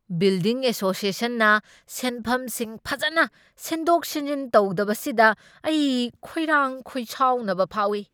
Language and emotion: Manipuri, angry